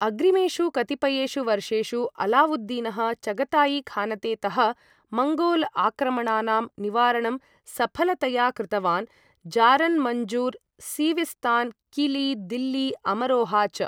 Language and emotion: Sanskrit, neutral